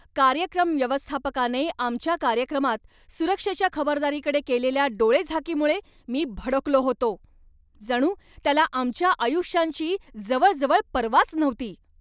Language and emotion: Marathi, angry